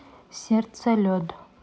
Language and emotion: Russian, neutral